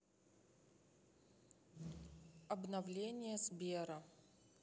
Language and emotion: Russian, neutral